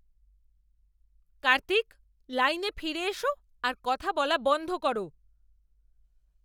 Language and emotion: Bengali, angry